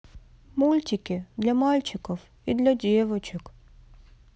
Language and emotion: Russian, sad